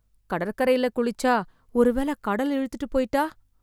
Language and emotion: Tamil, fearful